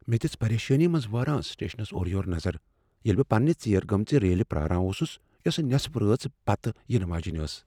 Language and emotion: Kashmiri, fearful